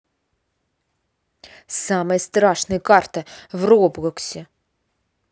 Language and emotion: Russian, angry